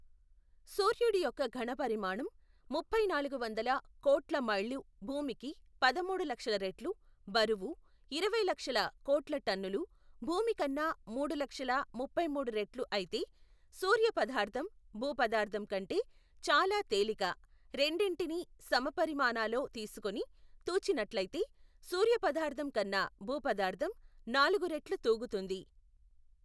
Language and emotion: Telugu, neutral